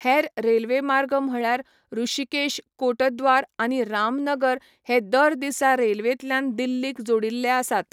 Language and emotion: Goan Konkani, neutral